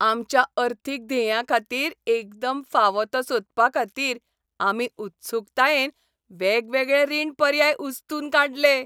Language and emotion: Goan Konkani, happy